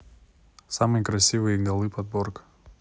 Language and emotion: Russian, neutral